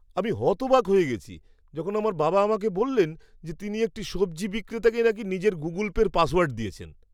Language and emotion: Bengali, surprised